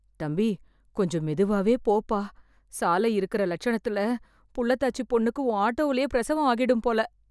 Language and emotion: Tamil, fearful